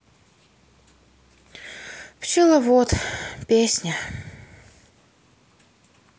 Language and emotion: Russian, sad